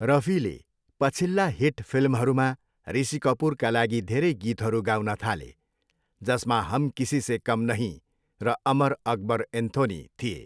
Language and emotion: Nepali, neutral